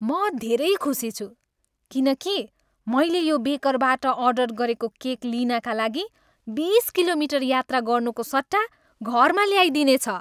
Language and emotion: Nepali, happy